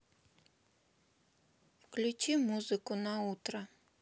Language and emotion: Russian, sad